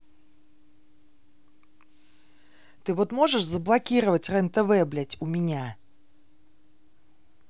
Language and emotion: Russian, angry